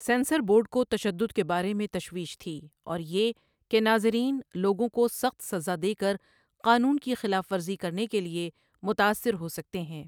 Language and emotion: Urdu, neutral